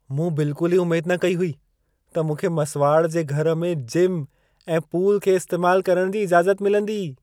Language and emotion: Sindhi, surprised